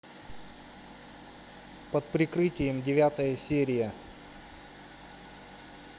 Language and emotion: Russian, neutral